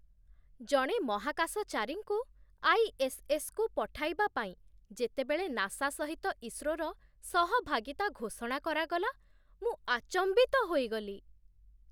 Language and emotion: Odia, surprised